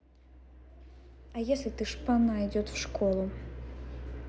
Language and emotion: Russian, angry